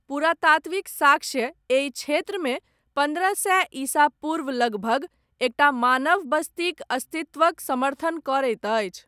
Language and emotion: Maithili, neutral